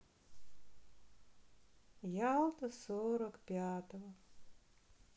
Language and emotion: Russian, sad